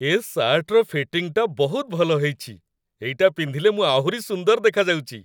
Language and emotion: Odia, happy